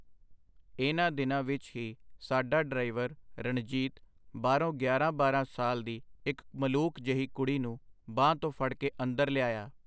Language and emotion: Punjabi, neutral